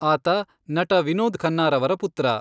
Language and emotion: Kannada, neutral